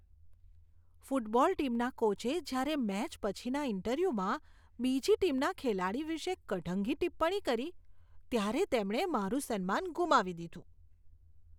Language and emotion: Gujarati, disgusted